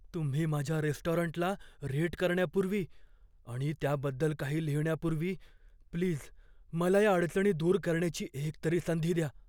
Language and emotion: Marathi, fearful